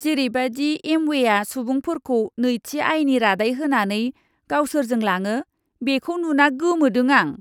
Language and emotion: Bodo, disgusted